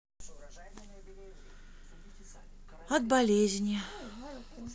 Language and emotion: Russian, sad